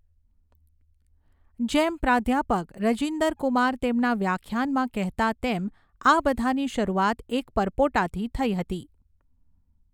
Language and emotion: Gujarati, neutral